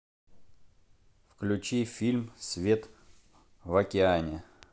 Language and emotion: Russian, neutral